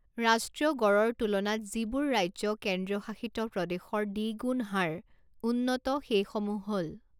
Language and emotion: Assamese, neutral